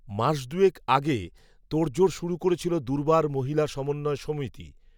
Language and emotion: Bengali, neutral